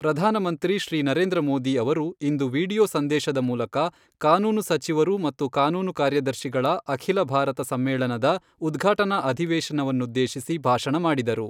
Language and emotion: Kannada, neutral